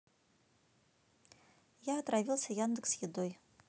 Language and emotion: Russian, neutral